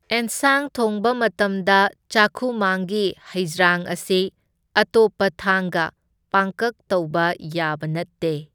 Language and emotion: Manipuri, neutral